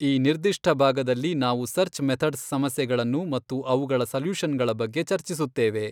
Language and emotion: Kannada, neutral